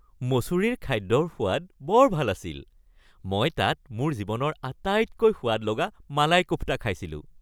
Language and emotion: Assamese, happy